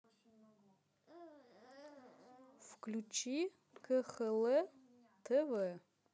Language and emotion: Russian, neutral